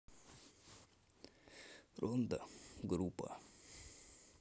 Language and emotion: Russian, sad